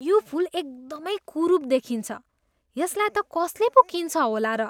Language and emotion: Nepali, disgusted